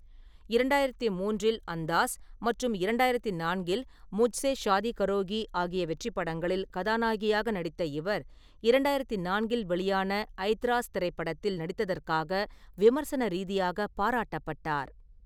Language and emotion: Tamil, neutral